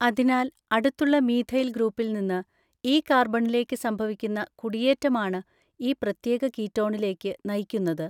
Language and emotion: Malayalam, neutral